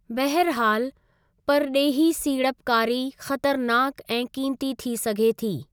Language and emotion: Sindhi, neutral